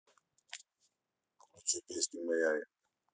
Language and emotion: Russian, neutral